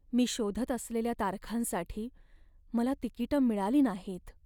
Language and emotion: Marathi, sad